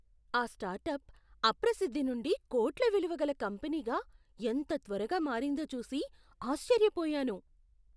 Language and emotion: Telugu, surprised